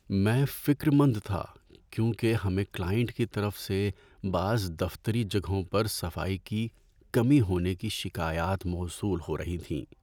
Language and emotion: Urdu, sad